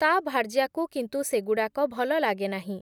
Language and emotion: Odia, neutral